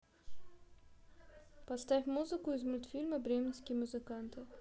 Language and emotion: Russian, neutral